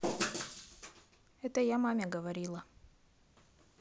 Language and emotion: Russian, neutral